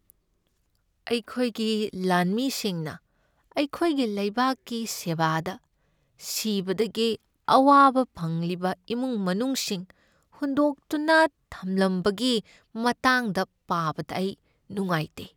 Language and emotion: Manipuri, sad